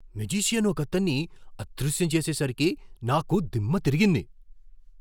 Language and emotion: Telugu, surprised